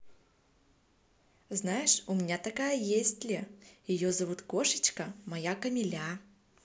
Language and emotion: Russian, positive